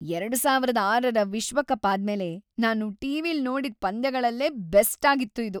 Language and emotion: Kannada, happy